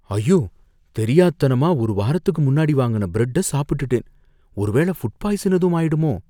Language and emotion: Tamil, fearful